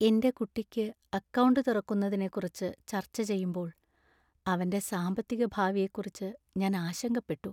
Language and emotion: Malayalam, sad